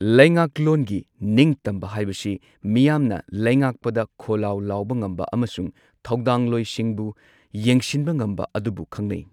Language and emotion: Manipuri, neutral